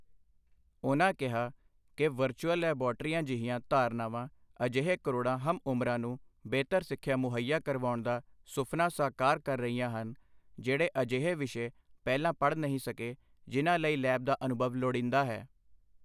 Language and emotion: Punjabi, neutral